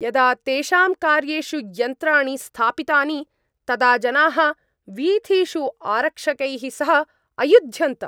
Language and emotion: Sanskrit, angry